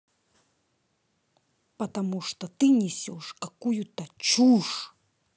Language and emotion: Russian, angry